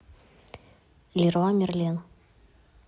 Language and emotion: Russian, neutral